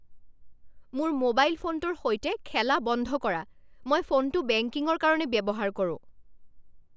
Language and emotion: Assamese, angry